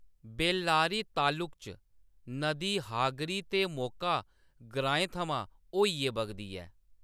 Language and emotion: Dogri, neutral